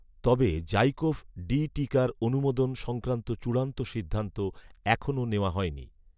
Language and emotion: Bengali, neutral